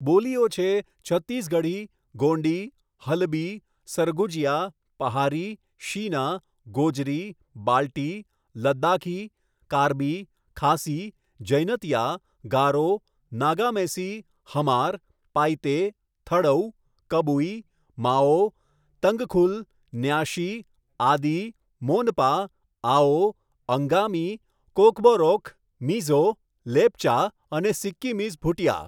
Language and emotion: Gujarati, neutral